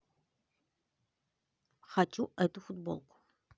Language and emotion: Russian, neutral